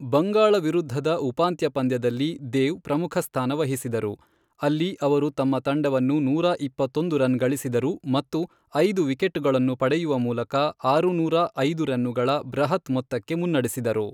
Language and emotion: Kannada, neutral